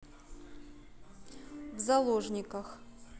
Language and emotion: Russian, neutral